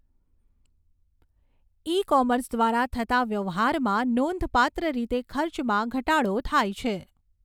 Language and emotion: Gujarati, neutral